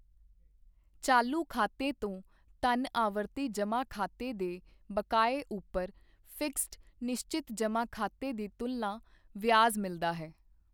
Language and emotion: Punjabi, neutral